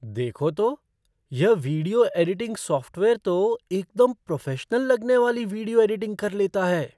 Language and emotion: Hindi, surprised